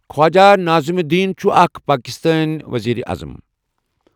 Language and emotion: Kashmiri, neutral